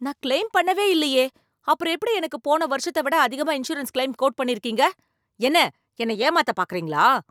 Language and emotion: Tamil, angry